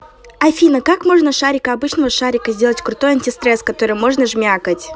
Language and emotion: Russian, neutral